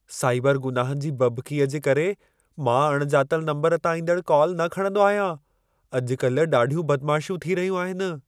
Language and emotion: Sindhi, fearful